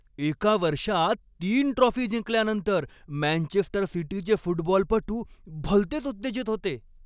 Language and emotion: Marathi, happy